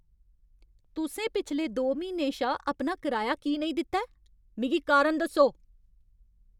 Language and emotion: Dogri, angry